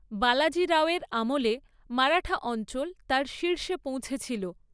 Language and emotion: Bengali, neutral